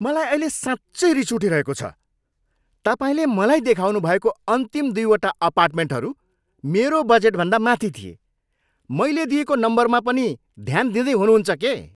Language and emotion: Nepali, angry